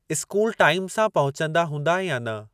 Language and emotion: Sindhi, neutral